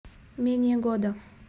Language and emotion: Russian, neutral